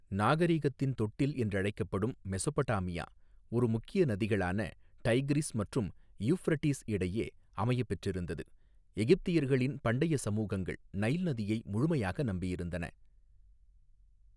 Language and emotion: Tamil, neutral